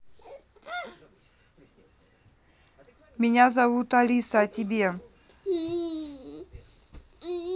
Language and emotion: Russian, neutral